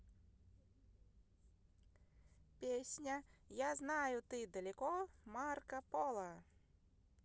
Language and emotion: Russian, positive